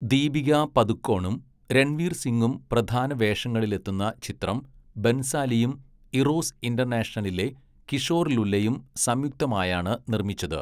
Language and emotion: Malayalam, neutral